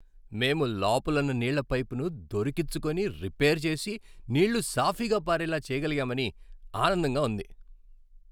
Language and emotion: Telugu, happy